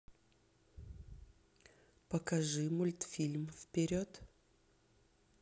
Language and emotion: Russian, neutral